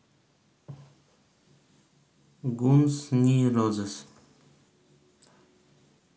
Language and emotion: Russian, neutral